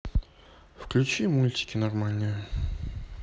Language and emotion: Russian, neutral